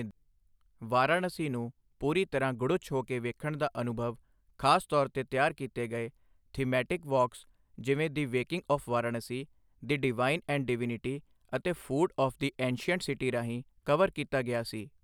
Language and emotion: Punjabi, neutral